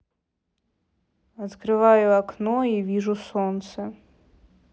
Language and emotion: Russian, neutral